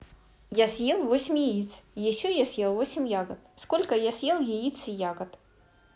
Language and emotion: Russian, neutral